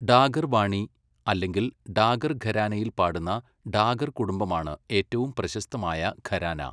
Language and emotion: Malayalam, neutral